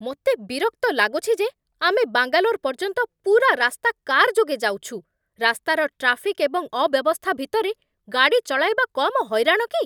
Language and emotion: Odia, angry